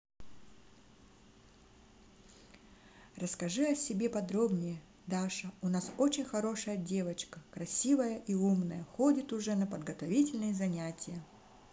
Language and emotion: Russian, positive